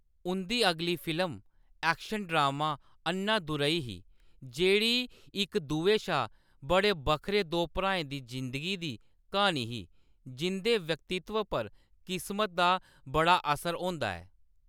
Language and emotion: Dogri, neutral